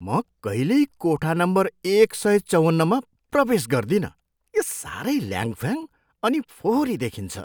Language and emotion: Nepali, disgusted